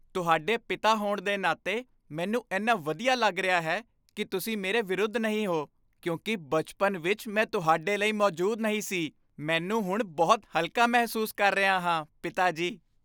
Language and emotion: Punjabi, happy